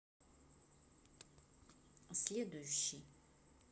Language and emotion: Russian, neutral